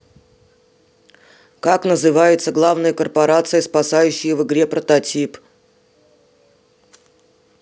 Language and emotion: Russian, neutral